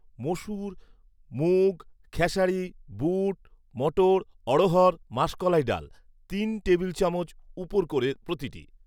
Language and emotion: Bengali, neutral